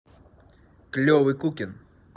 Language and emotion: Russian, positive